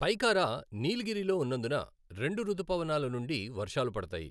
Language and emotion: Telugu, neutral